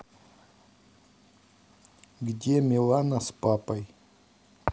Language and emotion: Russian, neutral